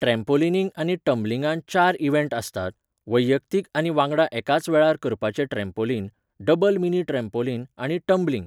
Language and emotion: Goan Konkani, neutral